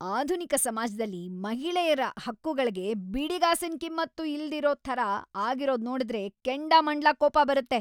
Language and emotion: Kannada, angry